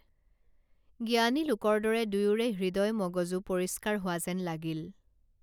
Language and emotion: Assamese, neutral